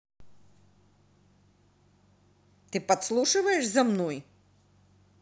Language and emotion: Russian, angry